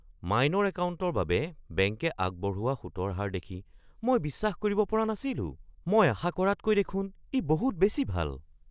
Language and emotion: Assamese, surprised